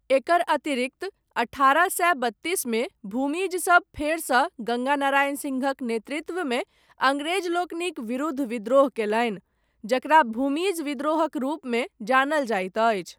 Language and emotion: Maithili, neutral